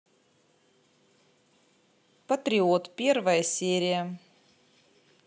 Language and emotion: Russian, neutral